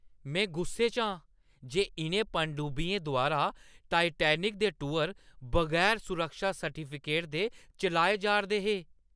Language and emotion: Dogri, angry